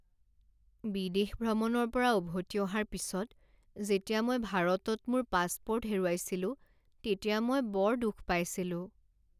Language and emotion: Assamese, sad